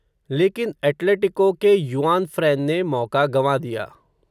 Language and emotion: Hindi, neutral